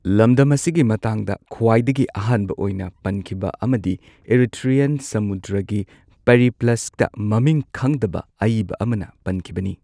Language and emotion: Manipuri, neutral